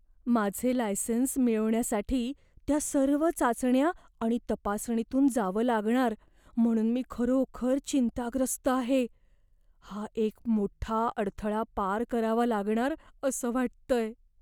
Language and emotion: Marathi, fearful